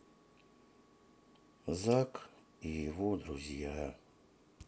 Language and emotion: Russian, sad